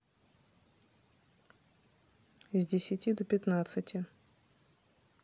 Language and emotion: Russian, neutral